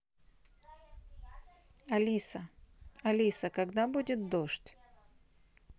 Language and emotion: Russian, neutral